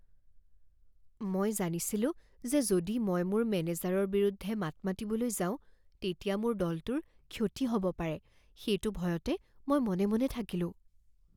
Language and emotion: Assamese, fearful